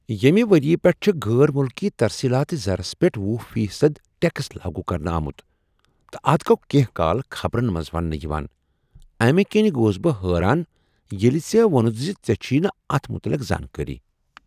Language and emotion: Kashmiri, surprised